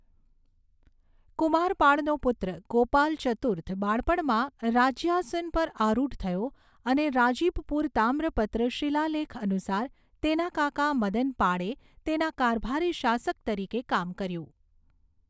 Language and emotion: Gujarati, neutral